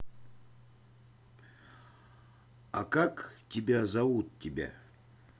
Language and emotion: Russian, neutral